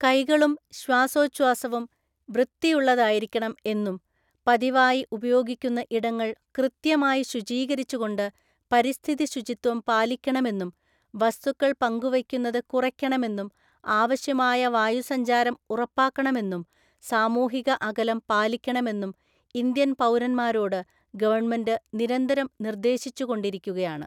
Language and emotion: Malayalam, neutral